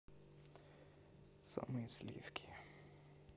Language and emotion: Russian, neutral